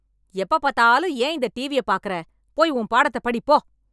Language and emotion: Tamil, angry